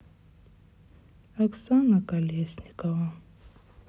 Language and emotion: Russian, sad